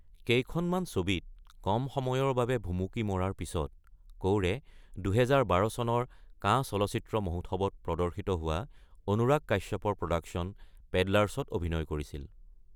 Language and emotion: Assamese, neutral